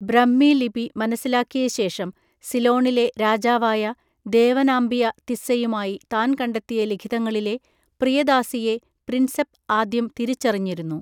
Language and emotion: Malayalam, neutral